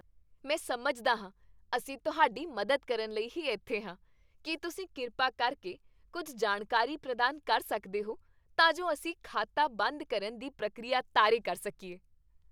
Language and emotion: Punjabi, happy